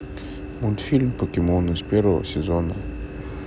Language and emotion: Russian, neutral